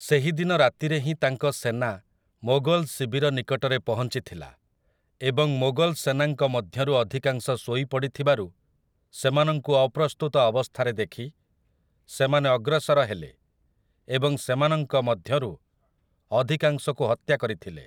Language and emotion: Odia, neutral